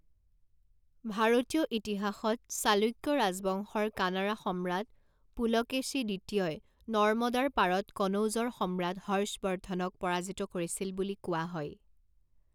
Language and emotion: Assamese, neutral